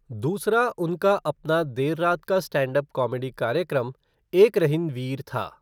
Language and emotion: Hindi, neutral